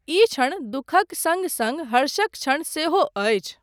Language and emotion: Maithili, neutral